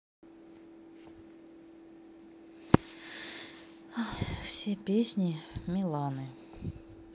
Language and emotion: Russian, sad